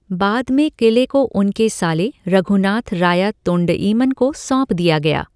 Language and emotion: Hindi, neutral